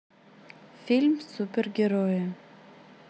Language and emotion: Russian, neutral